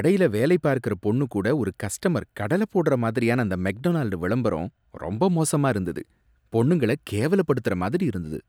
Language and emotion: Tamil, disgusted